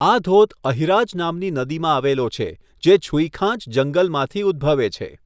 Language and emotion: Gujarati, neutral